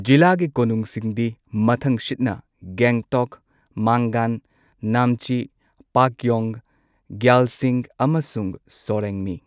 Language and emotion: Manipuri, neutral